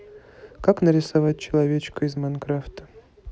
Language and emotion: Russian, neutral